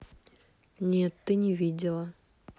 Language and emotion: Russian, neutral